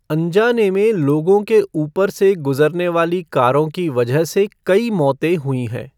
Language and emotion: Hindi, neutral